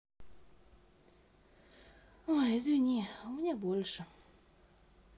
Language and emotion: Russian, sad